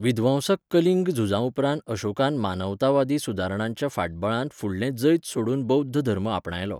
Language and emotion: Goan Konkani, neutral